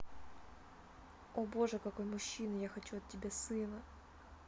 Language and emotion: Russian, neutral